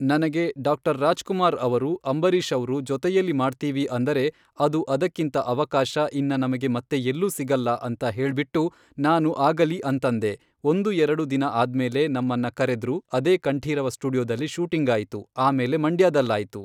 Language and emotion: Kannada, neutral